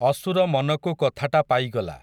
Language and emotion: Odia, neutral